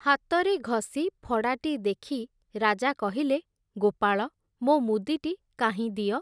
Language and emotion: Odia, neutral